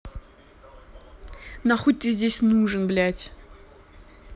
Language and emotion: Russian, angry